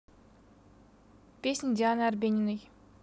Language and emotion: Russian, neutral